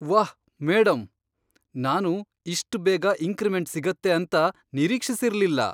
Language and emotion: Kannada, surprised